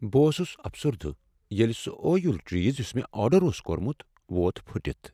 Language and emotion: Kashmiri, sad